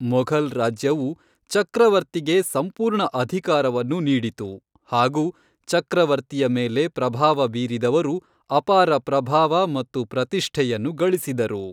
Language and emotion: Kannada, neutral